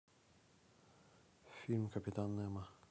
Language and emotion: Russian, neutral